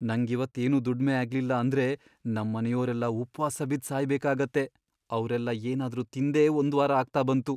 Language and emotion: Kannada, fearful